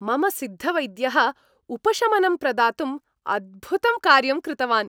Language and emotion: Sanskrit, happy